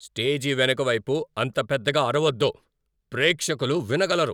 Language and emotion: Telugu, angry